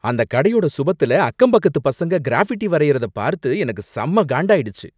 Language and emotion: Tamil, angry